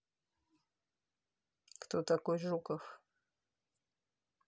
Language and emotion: Russian, neutral